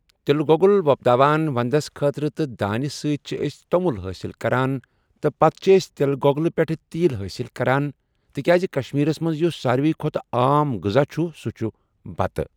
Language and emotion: Kashmiri, neutral